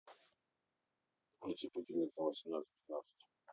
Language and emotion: Russian, neutral